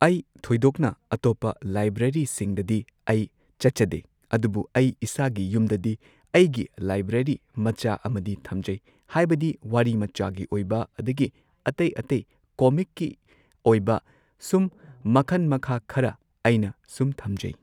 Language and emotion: Manipuri, neutral